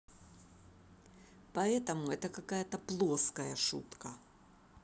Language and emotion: Russian, angry